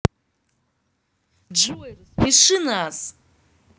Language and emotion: Russian, positive